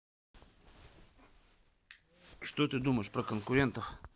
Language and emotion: Russian, neutral